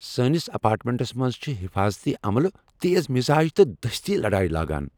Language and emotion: Kashmiri, angry